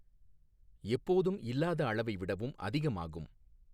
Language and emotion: Tamil, neutral